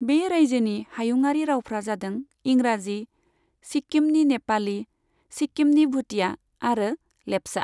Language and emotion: Bodo, neutral